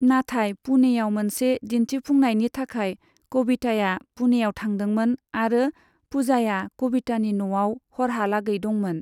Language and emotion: Bodo, neutral